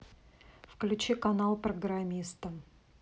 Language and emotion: Russian, neutral